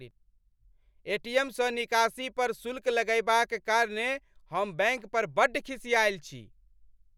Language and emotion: Maithili, angry